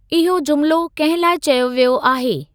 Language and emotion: Sindhi, neutral